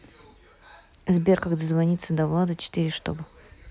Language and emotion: Russian, neutral